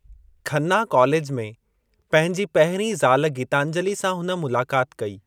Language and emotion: Sindhi, neutral